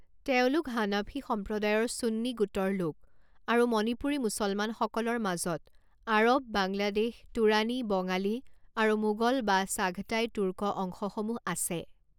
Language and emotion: Assamese, neutral